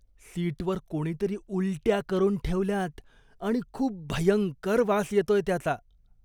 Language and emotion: Marathi, disgusted